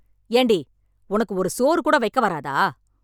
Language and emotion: Tamil, angry